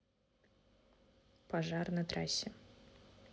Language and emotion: Russian, neutral